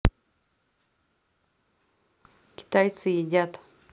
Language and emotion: Russian, neutral